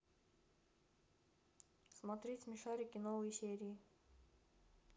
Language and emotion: Russian, neutral